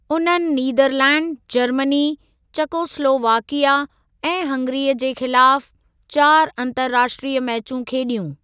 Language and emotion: Sindhi, neutral